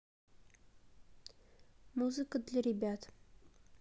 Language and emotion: Russian, neutral